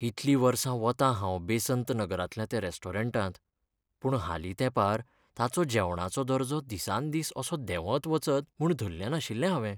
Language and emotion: Goan Konkani, sad